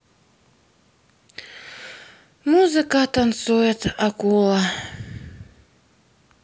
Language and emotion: Russian, sad